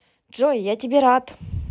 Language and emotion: Russian, positive